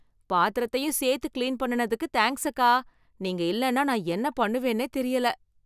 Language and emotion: Tamil, happy